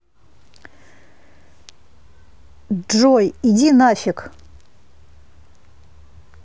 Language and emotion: Russian, angry